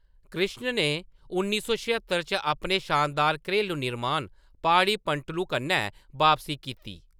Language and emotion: Dogri, neutral